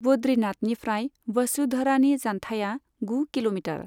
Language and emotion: Bodo, neutral